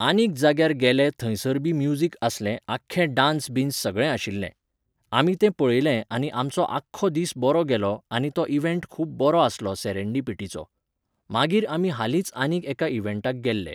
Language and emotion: Goan Konkani, neutral